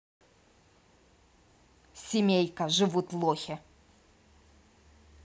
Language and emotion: Russian, angry